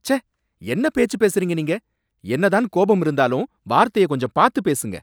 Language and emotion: Tamil, angry